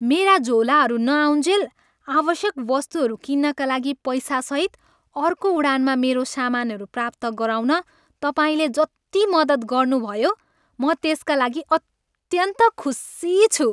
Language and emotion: Nepali, happy